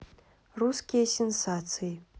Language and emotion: Russian, neutral